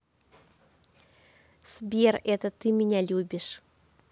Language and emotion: Russian, positive